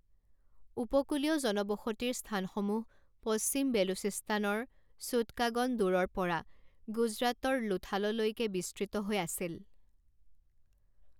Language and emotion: Assamese, neutral